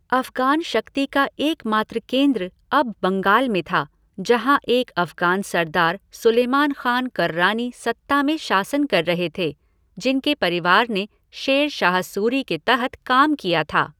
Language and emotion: Hindi, neutral